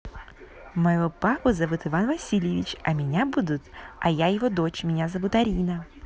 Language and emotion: Russian, positive